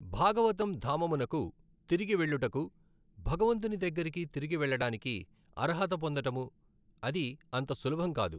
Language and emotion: Telugu, neutral